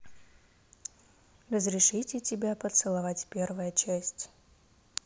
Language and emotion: Russian, neutral